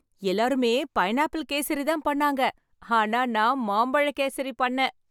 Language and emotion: Tamil, happy